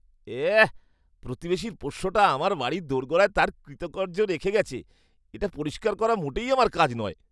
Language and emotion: Bengali, disgusted